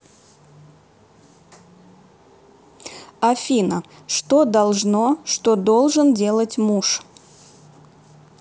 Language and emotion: Russian, neutral